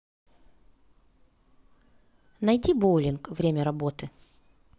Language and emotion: Russian, neutral